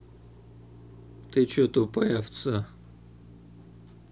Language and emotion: Russian, angry